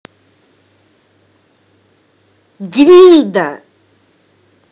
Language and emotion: Russian, angry